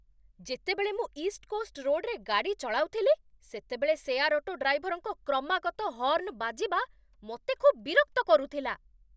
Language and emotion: Odia, angry